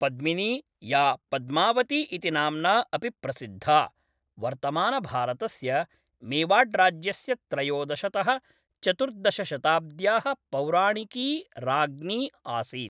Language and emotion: Sanskrit, neutral